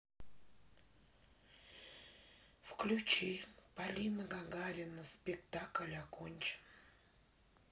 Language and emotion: Russian, sad